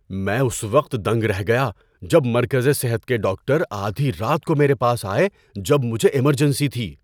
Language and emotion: Urdu, surprised